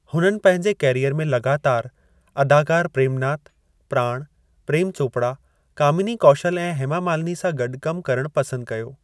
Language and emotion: Sindhi, neutral